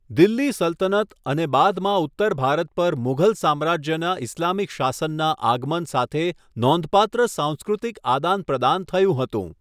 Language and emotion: Gujarati, neutral